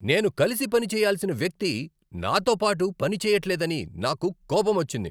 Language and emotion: Telugu, angry